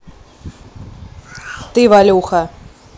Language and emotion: Russian, angry